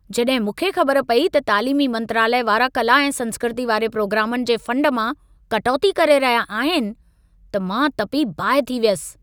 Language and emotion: Sindhi, angry